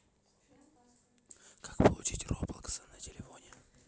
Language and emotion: Russian, neutral